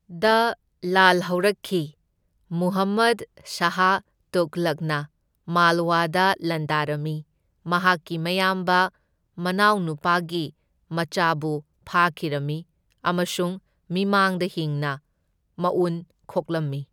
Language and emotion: Manipuri, neutral